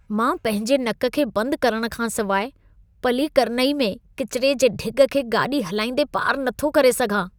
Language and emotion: Sindhi, disgusted